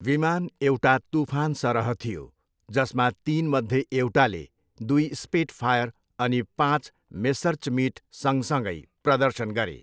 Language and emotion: Nepali, neutral